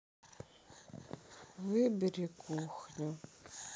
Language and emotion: Russian, sad